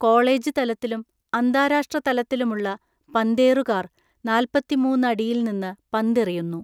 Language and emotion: Malayalam, neutral